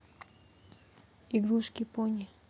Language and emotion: Russian, neutral